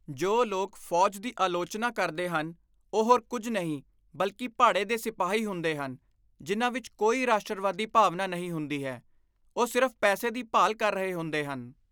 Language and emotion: Punjabi, disgusted